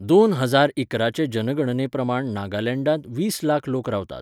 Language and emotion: Goan Konkani, neutral